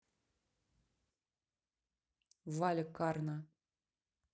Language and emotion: Russian, neutral